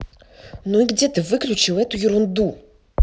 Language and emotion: Russian, angry